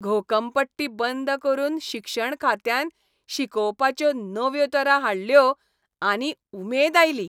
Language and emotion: Goan Konkani, happy